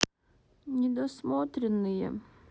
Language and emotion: Russian, sad